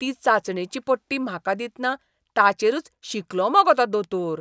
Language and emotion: Goan Konkani, disgusted